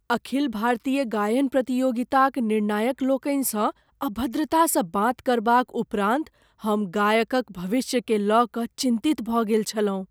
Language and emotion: Maithili, fearful